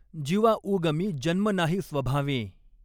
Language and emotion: Marathi, neutral